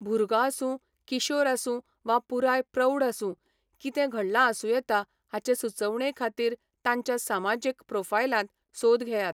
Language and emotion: Goan Konkani, neutral